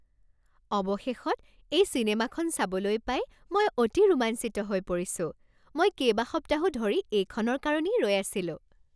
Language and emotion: Assamese, happy